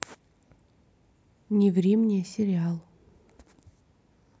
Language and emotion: Russian, neutral